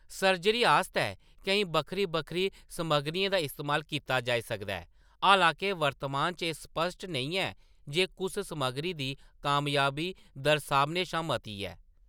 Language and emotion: Dogri, neutral